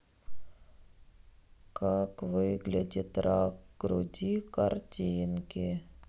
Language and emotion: Russian, sad